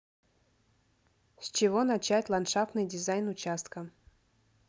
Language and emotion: Russian, neutral